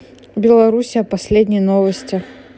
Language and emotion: Russian, neutral